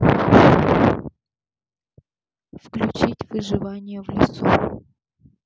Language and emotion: Russian, neutral